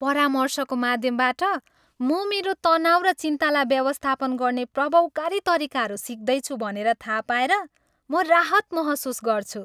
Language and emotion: Nepali, happy